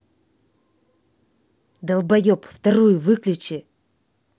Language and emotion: Russian, angry